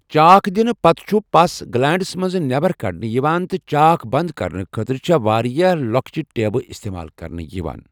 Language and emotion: Kashmiri, neutral